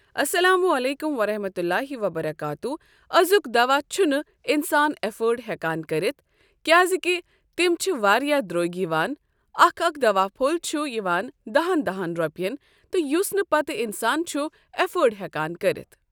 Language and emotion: Kashmiri, neutral